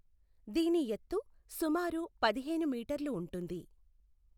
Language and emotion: Telugu, neutral